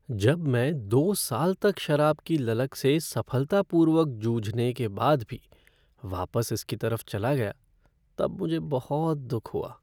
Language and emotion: Hindi, sad